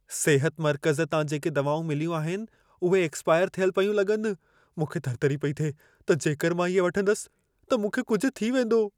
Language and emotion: Sindhi, fearful